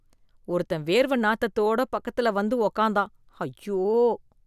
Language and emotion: Tamil, disgusted